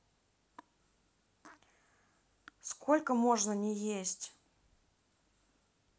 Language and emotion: Russian, neutral